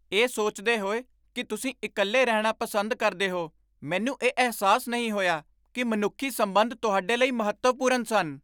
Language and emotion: Punjabi, surprised